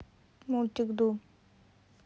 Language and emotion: Russian, neutral